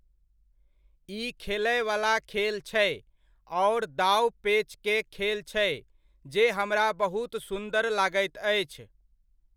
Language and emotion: Maithili, neutral